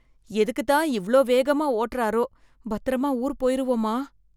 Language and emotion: Tamil, fearful